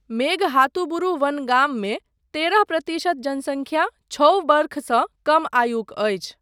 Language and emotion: Maithili, neutral